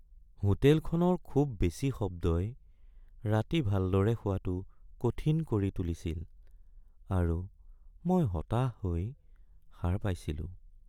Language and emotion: Assamese, sad